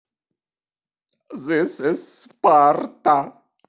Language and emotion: Russian, sad